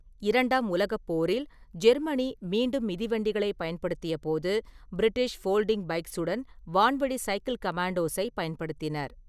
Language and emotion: Tamil, neutral